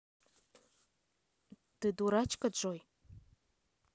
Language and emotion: Russian, neutral